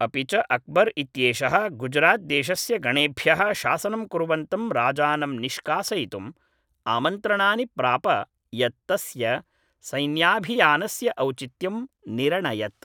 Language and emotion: Sanskrit, neutral